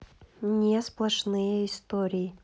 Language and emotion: Russian, neutral